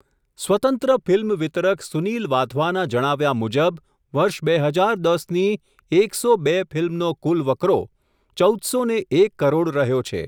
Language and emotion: Gujarati, neutral